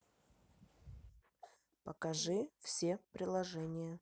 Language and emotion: Russian, neutral